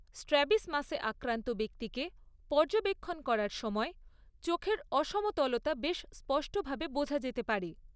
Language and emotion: Bengali, neutral